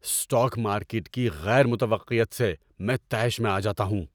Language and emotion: Urdu, angry